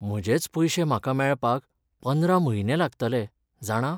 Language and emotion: Goan Konkani, sad